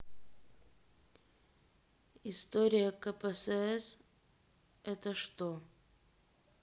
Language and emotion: Russian, neutral